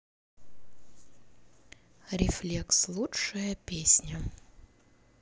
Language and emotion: Russian, neutral